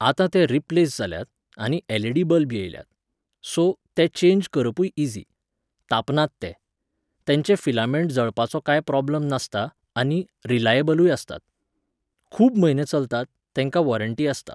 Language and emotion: Goan Konkani, neutral